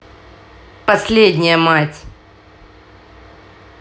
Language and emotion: Russian, neutral